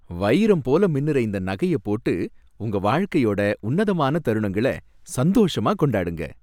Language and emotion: Tamil, happy